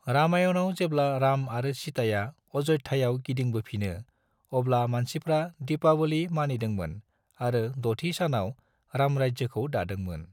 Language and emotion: Bodo, neutral